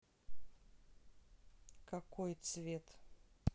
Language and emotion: Russian, neutral